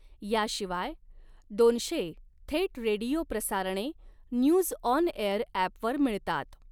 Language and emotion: Marathi, neutral